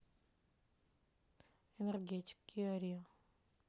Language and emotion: Russian, neutral